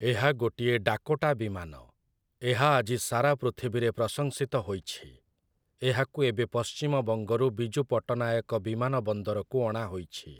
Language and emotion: Odia, neutral